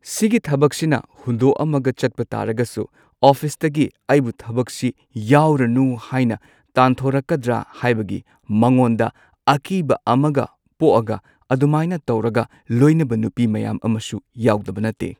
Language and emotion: Manipuri, neutral